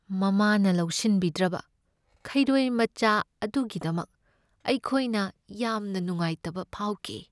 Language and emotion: Manipuri, sad